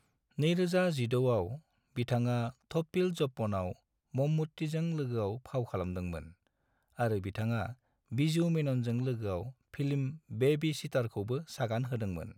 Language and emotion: Bodo, neutral